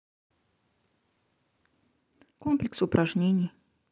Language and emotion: Russian, neutral